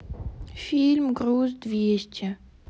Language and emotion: Russian, sad